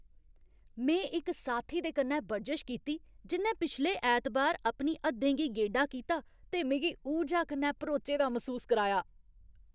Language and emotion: Dogri, happy